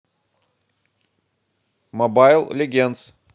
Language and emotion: Russian, neutral